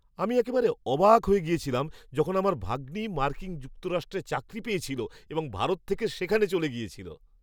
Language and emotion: Bengali, surprised